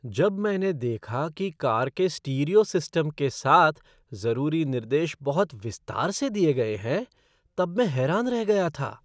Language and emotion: Hindi, surprised